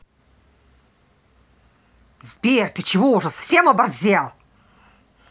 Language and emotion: Russian, angry